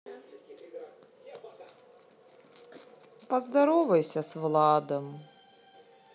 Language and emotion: Russian, sad